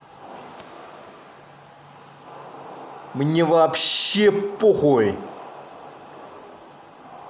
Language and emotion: Russian, angry